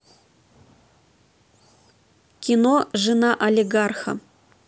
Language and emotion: Russian, neutral